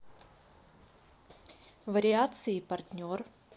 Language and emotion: Russian, neutral